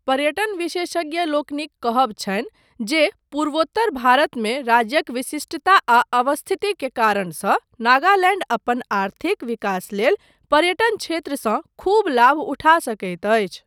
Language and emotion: Maithili, neutral